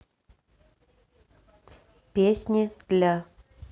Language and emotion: Russian, neutral